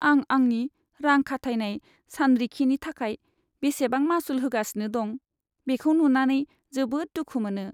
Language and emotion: Bodo, sad